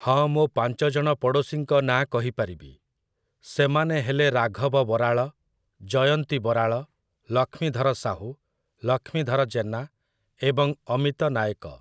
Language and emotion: Odia, neutral